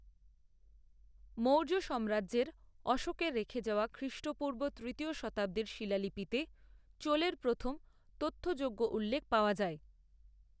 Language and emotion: Bengali, neutral